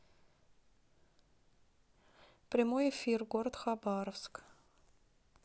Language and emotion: Russian, neutral